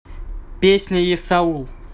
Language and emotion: Russian, neutral